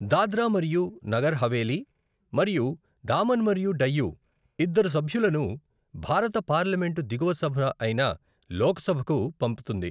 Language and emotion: Telugu, neutral